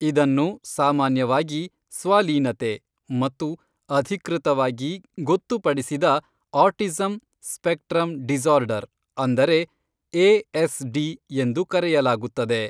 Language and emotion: Kannada, neutral